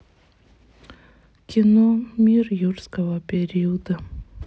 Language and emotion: Russian, sad